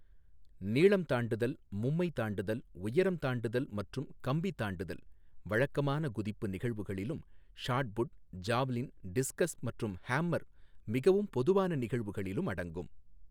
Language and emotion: Tamil, neutral